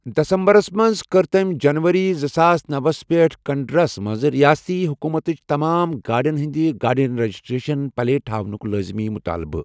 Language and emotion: Kashmiri, neutral